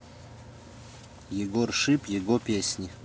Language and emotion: Russian, neutral